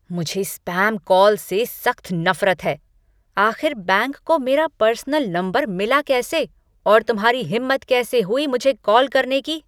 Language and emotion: Hindi, angry